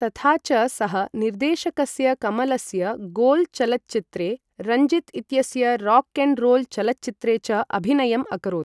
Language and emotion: Sanskrit, neutral